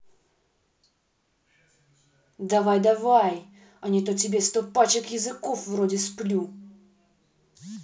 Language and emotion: Russian, angry